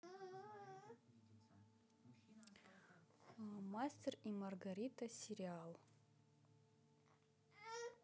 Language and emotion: Russian, neutral